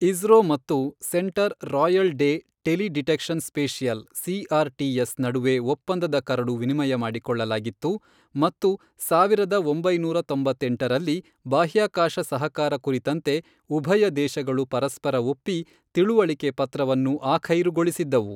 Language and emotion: Kannada, neutral